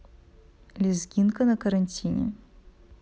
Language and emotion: Russian, neutral